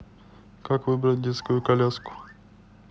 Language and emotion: Russian, neutral